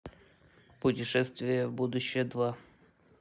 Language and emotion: Russian, neutral